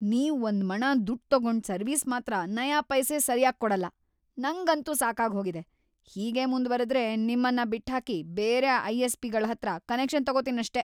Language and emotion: Kannada, angry